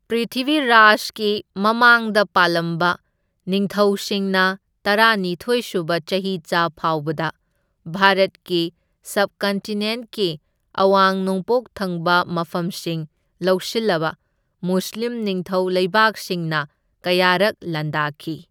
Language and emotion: Manipuri, neutral